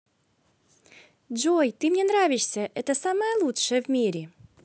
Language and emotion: Russian, positive